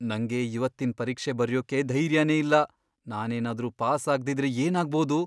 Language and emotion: Kannada, fearful